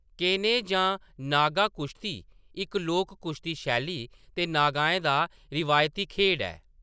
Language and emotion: Dogri, neutral